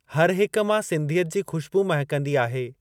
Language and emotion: Sindhi, neutral